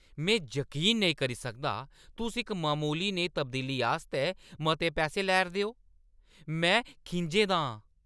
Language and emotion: Dogri, angry